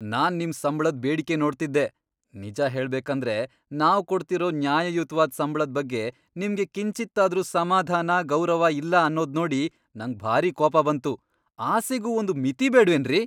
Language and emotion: Kannada, angry